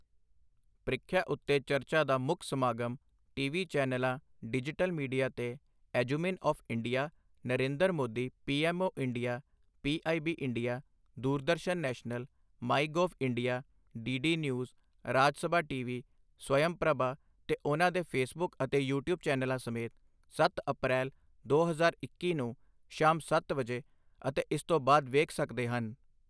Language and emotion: Punjabi, neutral